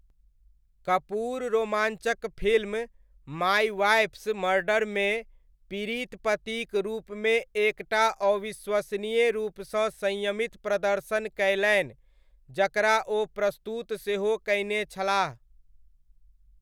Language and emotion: Maithili, neutral